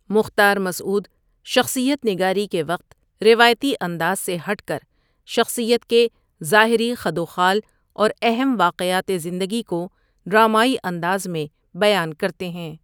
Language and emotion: Urdu, neutral